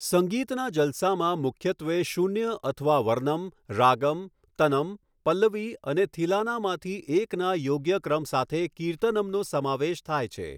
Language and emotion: Gujarati, neutral